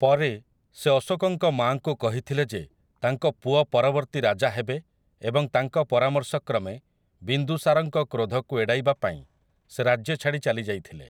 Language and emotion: Odia, neutral